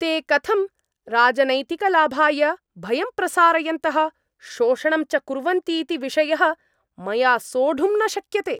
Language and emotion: Sanskrit, angry